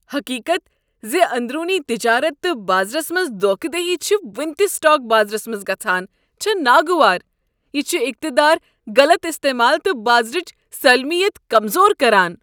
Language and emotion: Kashmiri, disgusted